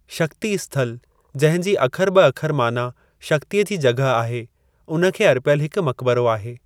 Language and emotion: Sindhi, neutral